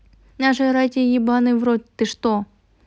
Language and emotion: Russian, angry